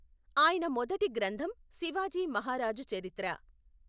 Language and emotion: Telugu, neutral